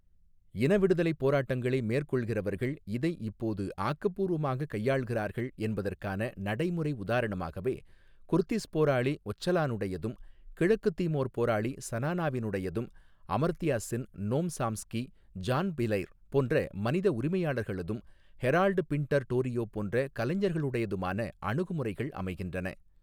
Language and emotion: Tamil, neutral